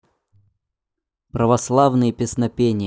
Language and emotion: Russian, neutral